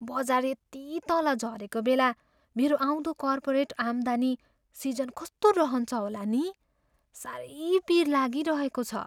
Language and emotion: Nepali, fearful